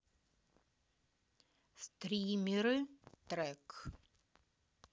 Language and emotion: Russian, neutral